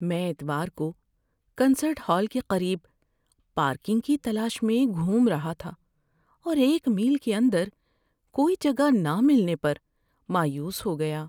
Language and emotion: Urdu, sad